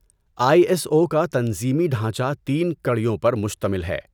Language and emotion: Urdu, neutral